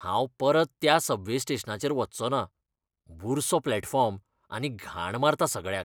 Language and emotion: Goan Konkani, disgusted